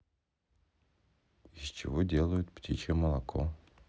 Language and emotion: Russian, neutral